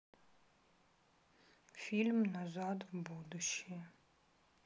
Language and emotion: Russian, sad